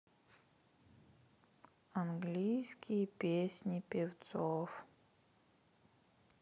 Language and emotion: Russian, sad